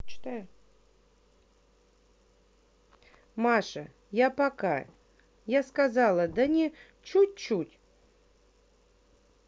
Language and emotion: Russian, neutral